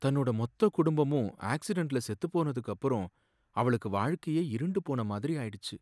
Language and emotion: Tamil, sad